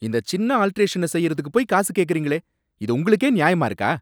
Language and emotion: Tamil, angry